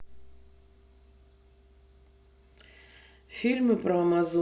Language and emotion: Russian, neutral